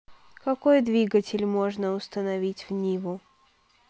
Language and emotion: Russian, neutral